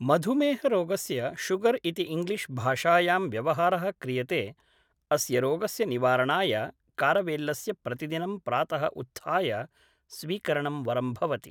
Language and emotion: Sanskrit, neutral